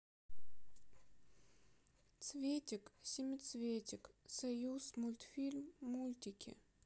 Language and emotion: Russian, sad